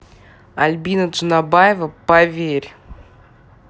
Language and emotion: Russian, angry